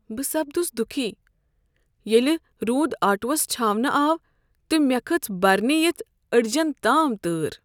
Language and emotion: Kashmiri, sad